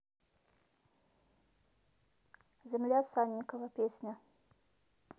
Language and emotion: Russian, neutral